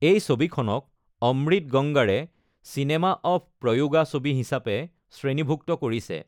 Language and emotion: Assamese, neutral